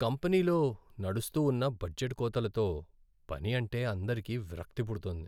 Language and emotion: Telugu, sad